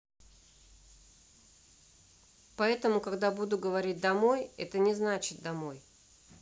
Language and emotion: Russian, neutral